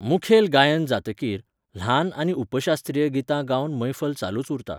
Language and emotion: Goan Konkani, neutral